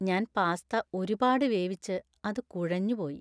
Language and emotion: Malayalam, sad